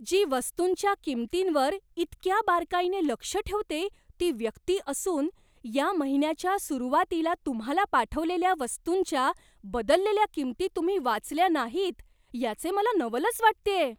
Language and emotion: Marathi, surprised